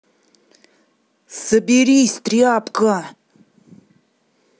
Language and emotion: Russian, angry